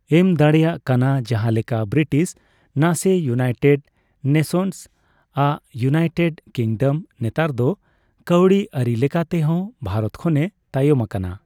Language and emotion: Santali, neutral